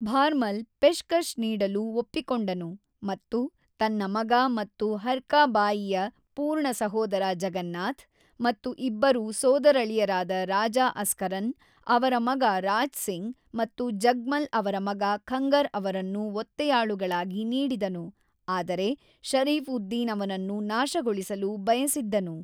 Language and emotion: Kannada, neutral